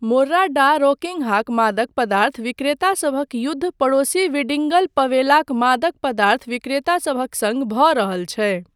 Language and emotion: Maithili, neutral